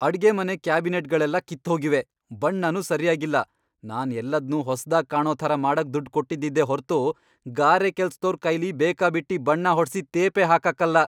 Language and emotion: Kannada, angry